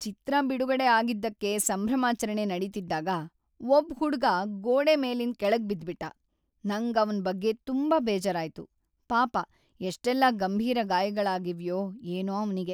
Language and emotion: Kannada, sad